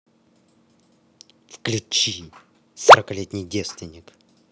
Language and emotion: Russian, angry